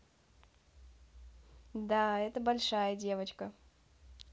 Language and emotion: Russian, neutral